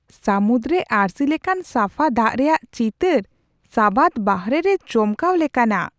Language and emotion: Santali, surprised